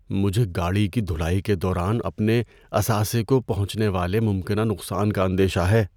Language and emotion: Urdu, fearful